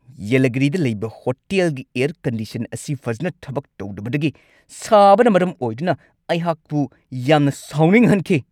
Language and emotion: Manipuri, angry